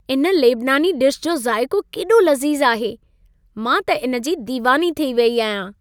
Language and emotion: Sindhi, happy